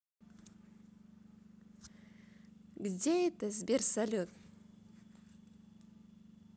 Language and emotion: Russian, positive